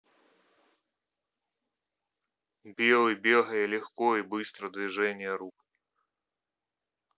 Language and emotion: Russian, neutral